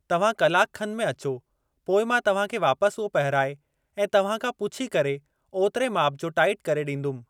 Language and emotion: Sindhi, neutral